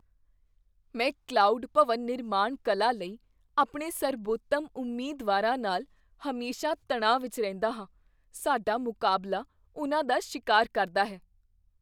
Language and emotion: Punjabi, fearful